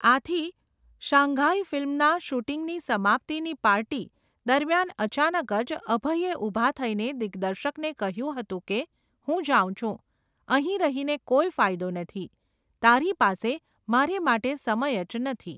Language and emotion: Gujarati, neutral